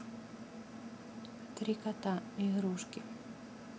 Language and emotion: Russian, neutral